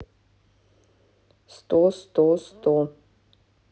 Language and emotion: Russian, neutral